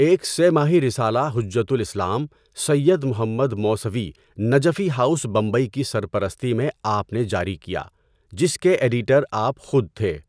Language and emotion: Urdu, neutral